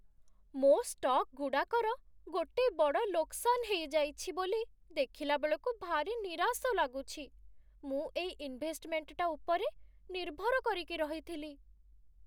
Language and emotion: Odia, sad